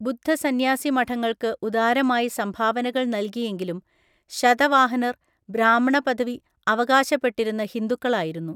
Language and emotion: Malayalam, neutral